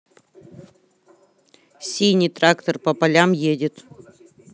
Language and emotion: Russian, neutral